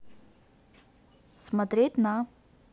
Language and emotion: Russian, neutral